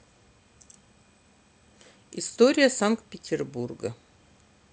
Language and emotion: Russian, neutral